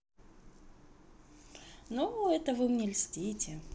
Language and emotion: Russian, positive